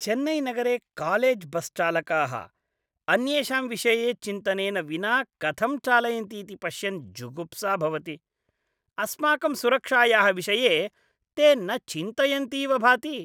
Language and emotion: Sanskrit, disgusted